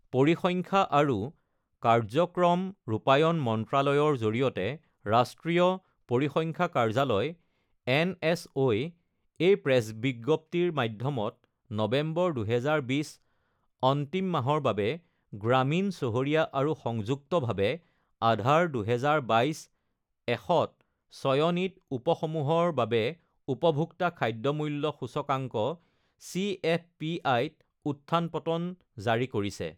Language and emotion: Assamese, neutral